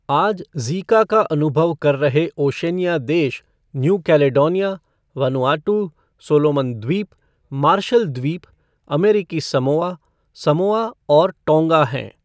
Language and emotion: Hindi, neutral